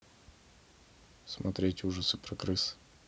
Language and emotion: Russian, neutral